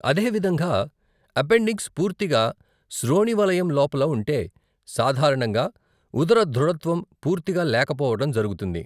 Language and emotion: Telugu, neutral